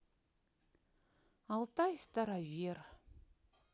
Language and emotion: Russian, sad